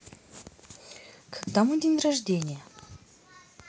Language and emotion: Russian, neutral